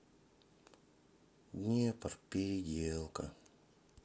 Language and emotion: Russian, sad